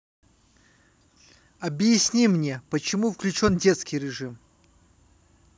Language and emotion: Russian, neutral